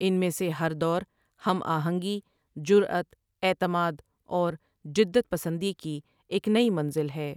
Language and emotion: Urdu, neutral